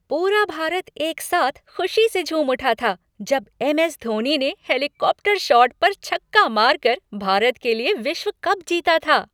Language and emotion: Hindi, happy